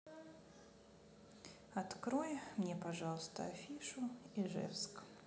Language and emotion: Russian, sad